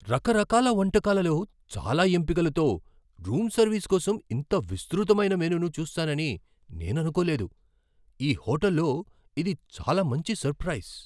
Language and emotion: Telugu, surprised